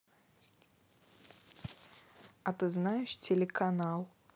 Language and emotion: Russian, neutral